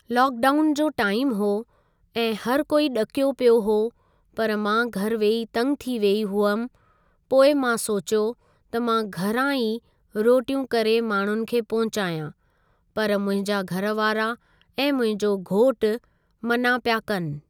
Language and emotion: Sindhi, neutral